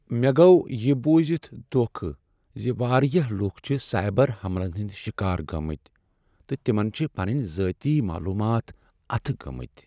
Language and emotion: Kashmiri, sad